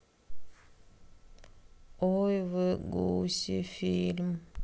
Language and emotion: Russian, sad